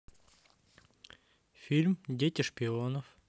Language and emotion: Russian, neutral